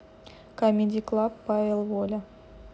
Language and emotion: Russian, neutral